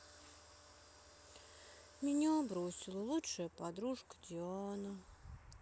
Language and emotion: Russian, sad